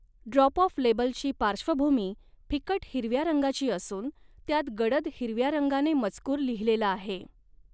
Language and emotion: Marathi, neutral